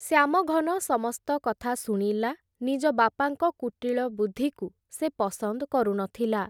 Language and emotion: Odia, neutral